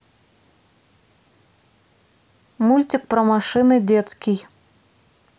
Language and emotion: Russian, neutral